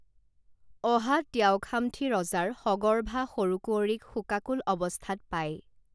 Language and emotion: Assamese, neutral